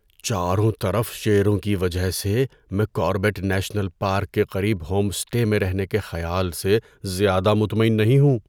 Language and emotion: Urdu, fearful